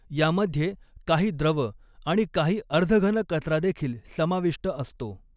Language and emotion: Marathi, neutral